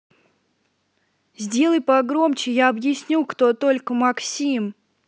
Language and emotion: Russian, angry